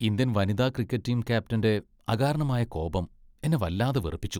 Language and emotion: Malayalam, disgusted